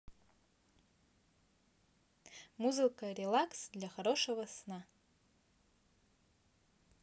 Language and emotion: Russian, positive